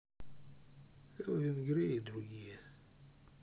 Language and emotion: Russian, sad